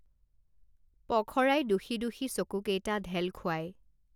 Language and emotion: Assamese, neutral